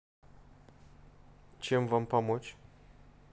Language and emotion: Russian, neutral